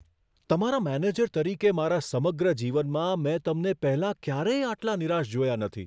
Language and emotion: Gujarati, surprised